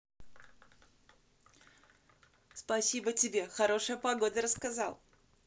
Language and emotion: Russian, positive